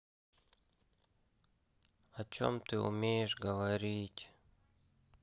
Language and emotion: Russian, sad